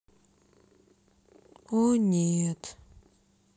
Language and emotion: Russian, sad